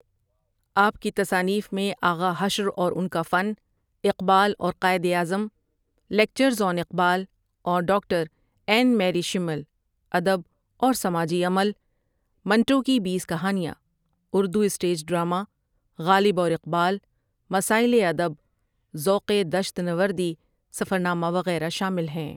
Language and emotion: Urdu, neutral